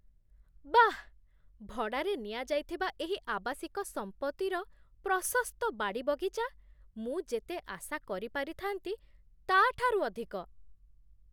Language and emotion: Odia, surprised